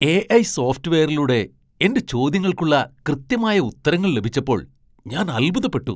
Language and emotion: Malayalam, surprised